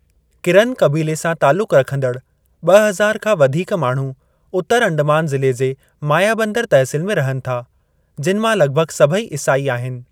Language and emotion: Sindhi, neutral